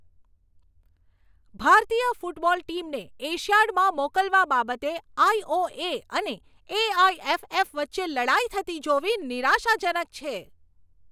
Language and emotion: Gujarati, angry